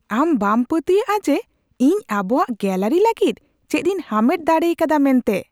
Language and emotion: Santali, surprised